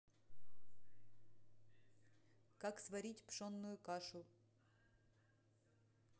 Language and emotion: Russian, neutral